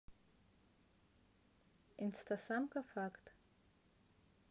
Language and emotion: Russian, neutral